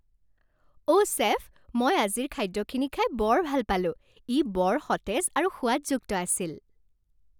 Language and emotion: Assamese, happy